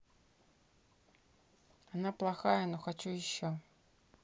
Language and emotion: Russian, neutral